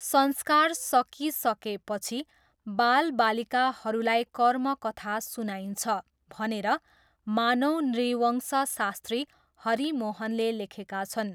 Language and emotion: Nepali, neutral